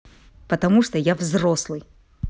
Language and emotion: Russian, angry